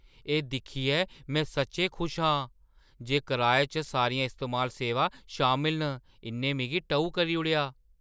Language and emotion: Dogri, surprised